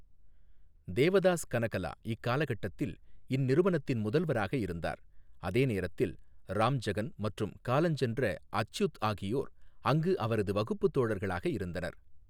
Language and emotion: Tamil, neutral